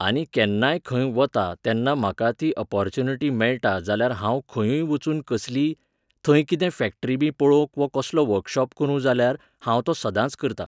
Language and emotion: Goan Konkani, neutral